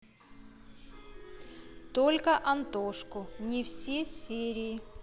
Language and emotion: Russian, neutral